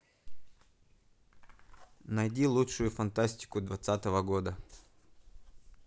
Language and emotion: Russian, neutral